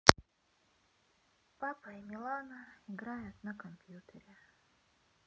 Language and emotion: Russian, sad